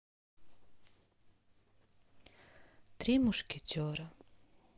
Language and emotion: Russian, sad